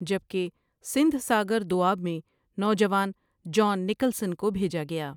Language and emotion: Urdu, neutral